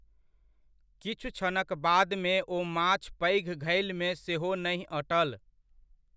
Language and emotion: Maithili, neutral